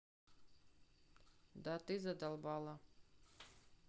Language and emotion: Russian, neutral